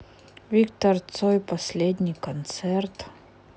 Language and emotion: Russian, sad